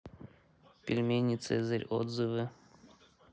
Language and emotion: Russian, neutral